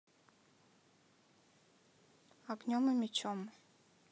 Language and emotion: Russian, neutral